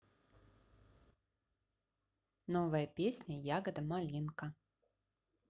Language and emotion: Russian, positive